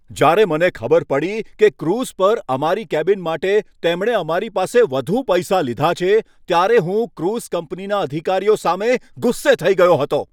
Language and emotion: Gujarati, angry